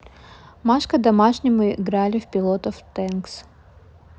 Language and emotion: Russian, neutral